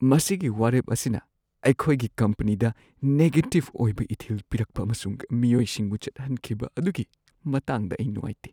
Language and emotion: Manipuri, sad